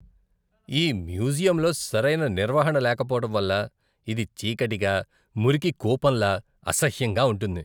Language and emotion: Telugu, disgusted